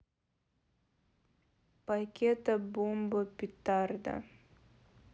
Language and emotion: Russian, neutral